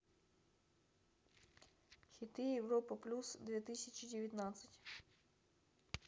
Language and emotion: Russian, neutral